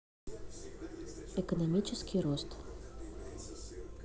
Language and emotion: Russian, neutral